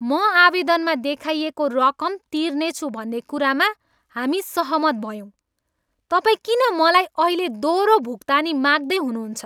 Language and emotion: Nepali, angry